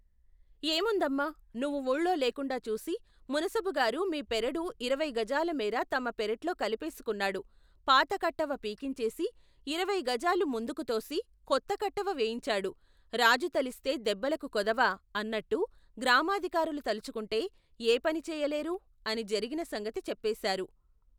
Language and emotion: Telugu, neutral